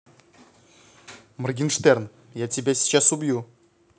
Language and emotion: Russian, neutral